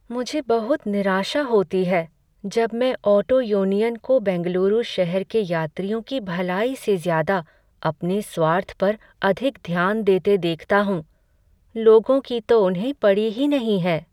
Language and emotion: Hindi, sad